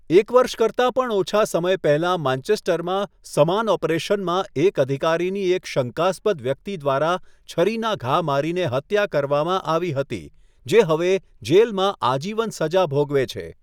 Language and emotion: Gujarati, neutral